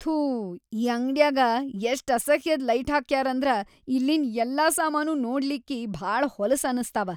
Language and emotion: Kannada, disgusted